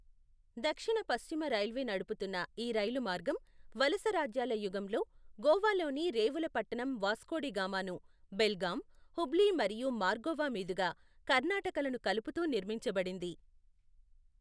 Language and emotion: Telugu, neutral